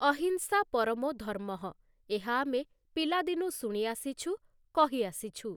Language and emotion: Odia, neutral